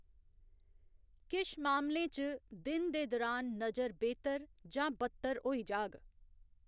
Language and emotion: Dogri, neutral